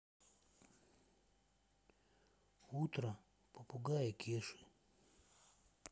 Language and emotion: Russian, sad